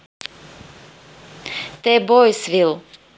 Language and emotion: Russian, neutral